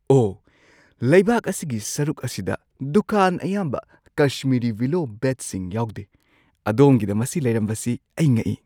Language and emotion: Manipuri, surprised